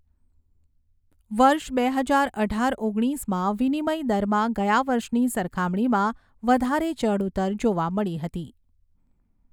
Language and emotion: Gujarati, neutral